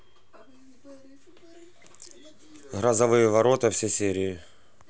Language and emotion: Russian, neutral